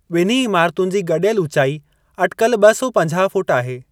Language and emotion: Sindhi, neutral